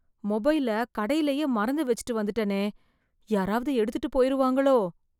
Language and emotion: Tamil, fearful